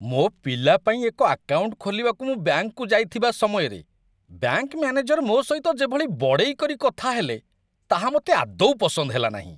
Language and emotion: Odia, disgusted